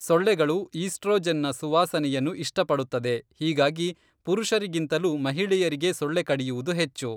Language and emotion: Kannada, neutral